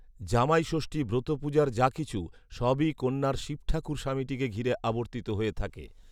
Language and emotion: Bengali, neutral